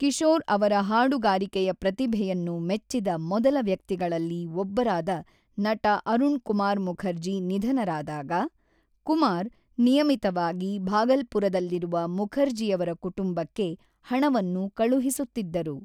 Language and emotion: Kannada, neutral